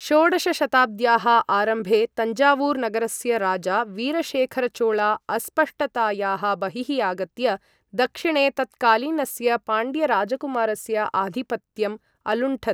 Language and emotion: Sanskrit, neutral